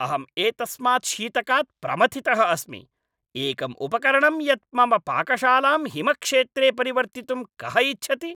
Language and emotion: Sanskrit, angry